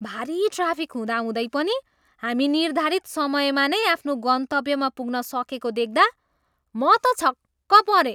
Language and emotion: Nepali, surprised